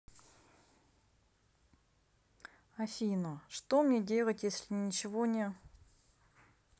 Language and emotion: Russian, sad